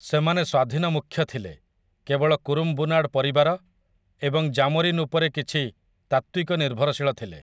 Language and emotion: Odia, neutral